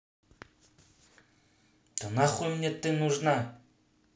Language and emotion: Russian, angry